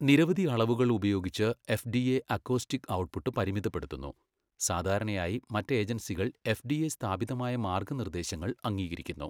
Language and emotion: Malayalam, neutral